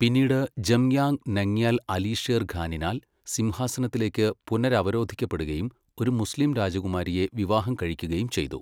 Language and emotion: Malayalam, neutral